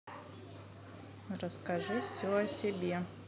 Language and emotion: Russian, neutral